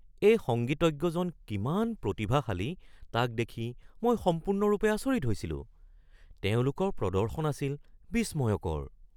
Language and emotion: Assamese, surprised